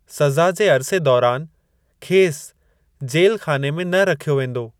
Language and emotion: Sindhi, neutral